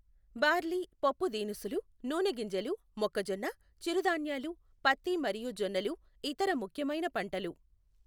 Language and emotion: Telugu, neutral